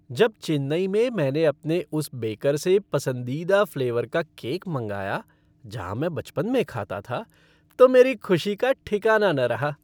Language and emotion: Hindi, happy